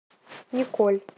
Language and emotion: Russian, neutral